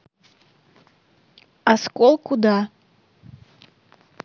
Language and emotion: Russian, neutral